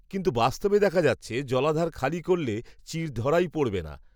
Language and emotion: Bengali, neutral